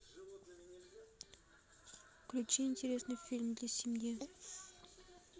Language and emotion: Russian, neutral